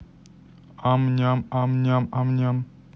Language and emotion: Russian, neutral